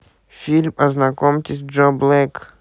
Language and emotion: Russian, neutral